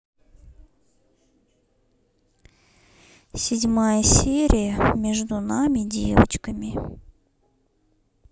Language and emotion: Russian, neutral